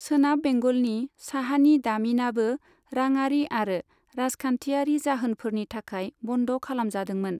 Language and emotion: Bodo, neutral